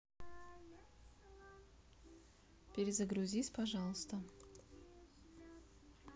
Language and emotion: Russian, neutral